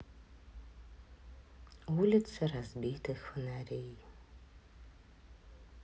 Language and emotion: Russian, sad